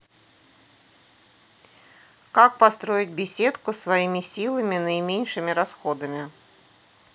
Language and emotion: Russian, neutral